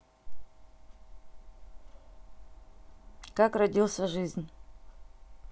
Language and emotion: Russian, neutral